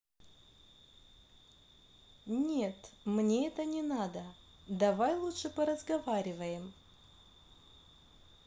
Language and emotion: Russian, neutral